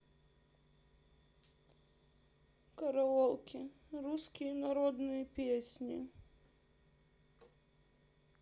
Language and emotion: Russian, sad